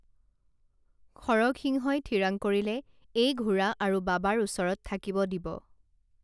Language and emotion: Assamese, neutral